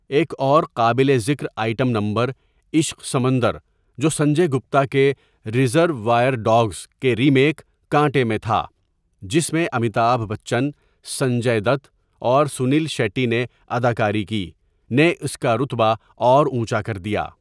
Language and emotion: Urdu, neutral